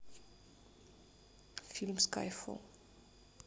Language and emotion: Russian, neutral